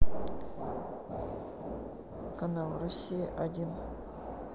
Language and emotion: Russian, neutral